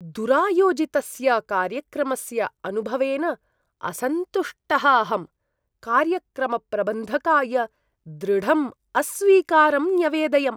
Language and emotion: Sanskrit, disgusted